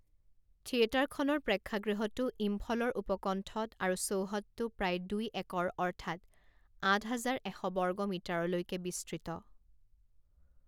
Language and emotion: Assamese, neutral